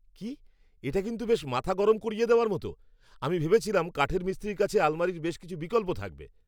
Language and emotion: Bengali, angry